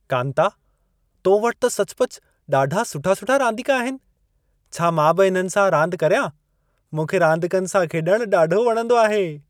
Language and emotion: Sindhi, happy